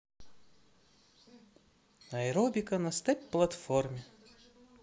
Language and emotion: Russian, neutral